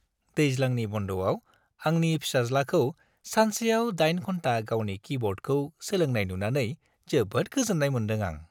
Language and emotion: Bodo, happy